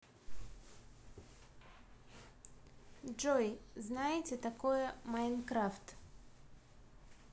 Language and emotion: Russian, neutral